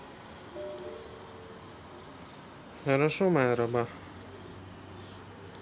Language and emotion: Russian, neutral